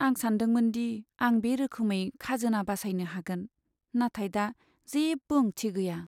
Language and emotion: Bodo, sad